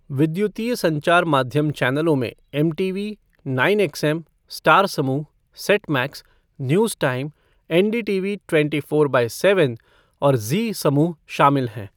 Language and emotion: Hindi, neutral